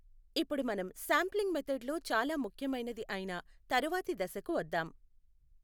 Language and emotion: Telugu, neutral